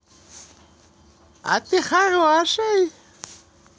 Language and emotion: Russian, positive